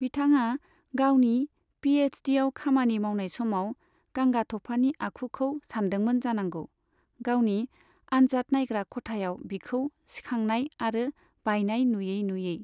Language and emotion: Bodo, neutral